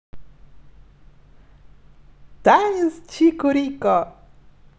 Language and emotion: Russian, positive